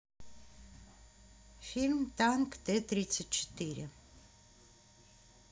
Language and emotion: Russian, neutral